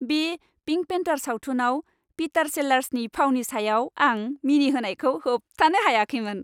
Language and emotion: Bodo, happy